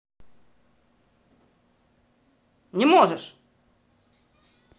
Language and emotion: Russian, angry